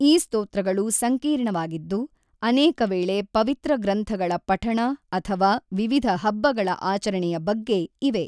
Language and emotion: Kannada, neutral